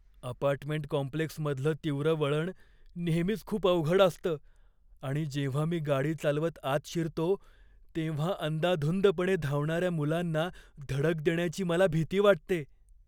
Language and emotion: Marathi, fearful